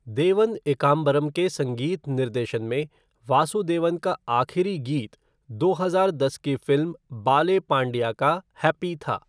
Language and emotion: Hindi, neutral